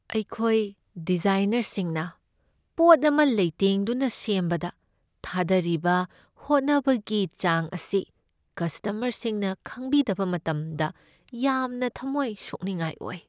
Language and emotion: Manipuri, sad